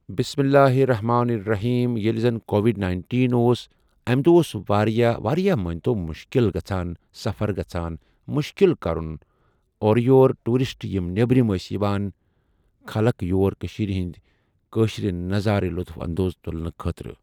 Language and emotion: Kashmiri, neutral